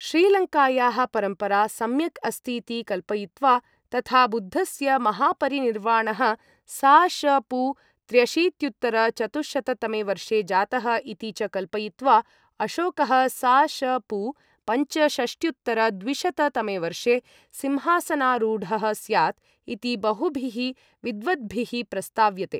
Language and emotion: Sanskrit, neutral